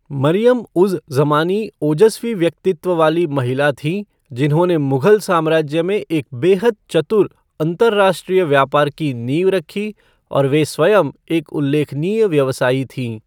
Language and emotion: Hindi, neutral